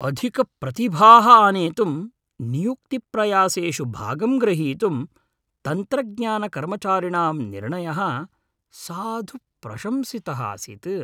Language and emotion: Sanskrit, happy